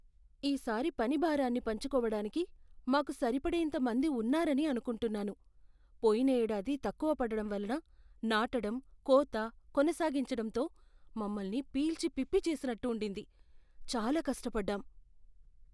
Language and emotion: Telugu, fearful